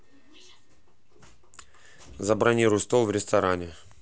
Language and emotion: Russian, neutral